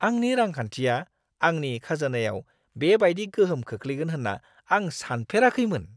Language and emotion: Bodo, surprised